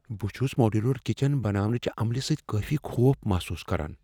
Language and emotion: Kashmiri, fearful